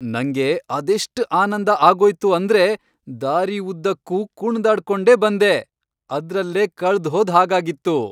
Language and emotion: Kannada, happy